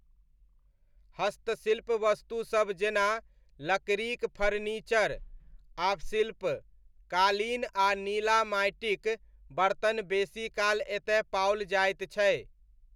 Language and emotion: Maithili, neutral